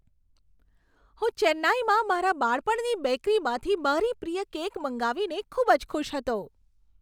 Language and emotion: Gujarati, happy